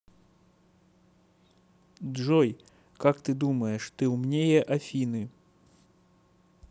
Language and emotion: Russian, neutral